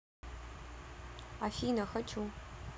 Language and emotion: Russian, neutral